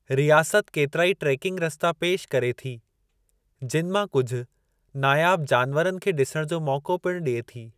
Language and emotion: Sindhi, neutral